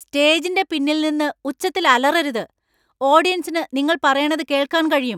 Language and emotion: Malayalam, angry